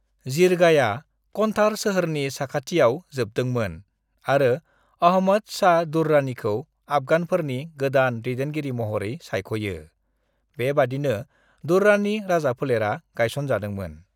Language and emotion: Bodo, neutral